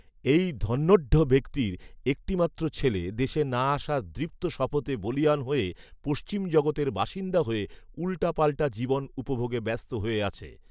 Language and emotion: Bengali, neutral